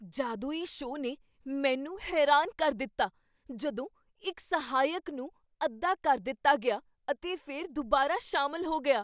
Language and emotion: Punjabi, surprised